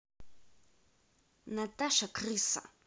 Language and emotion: Russian, angry